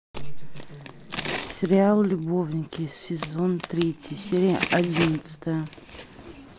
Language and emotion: Russian, neutral